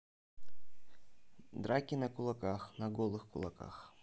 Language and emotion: Russian, neutral